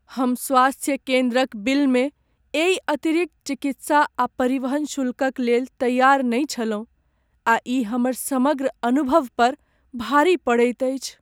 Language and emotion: Maithili, sad